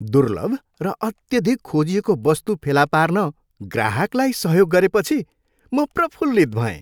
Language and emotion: Nepali, happy